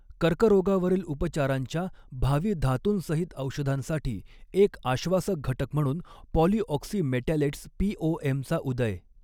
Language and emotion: Marathi, neutral